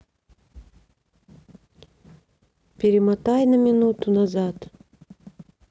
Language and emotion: Russian, neutral